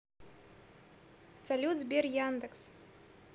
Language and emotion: Russian, neutral